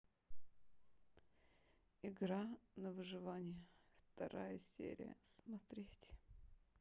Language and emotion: Russian, sad